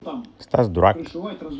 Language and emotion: Russian, neutral